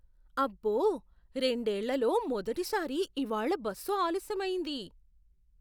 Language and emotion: Telugu, surprised